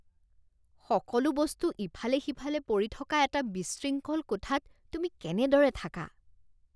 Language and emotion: Assamese, disgusted